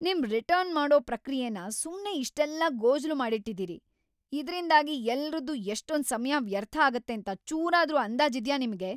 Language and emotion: Kannada, angry